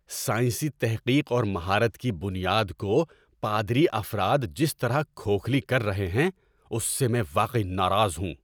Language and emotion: Urdu, angry